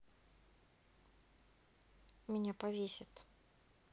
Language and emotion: Russian, sad